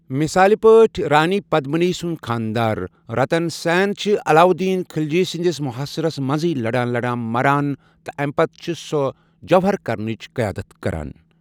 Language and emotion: Kashmiri, neutral